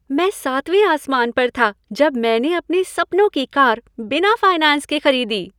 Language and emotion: Hindi, happy